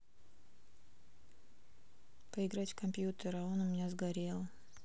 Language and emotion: Russian, sad